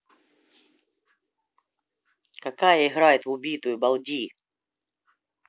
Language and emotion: Russian, angry